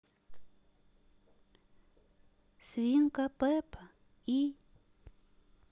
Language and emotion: Russian, neutral